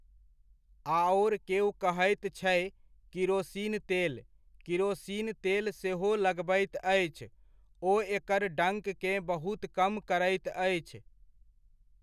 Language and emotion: Maithili, neutral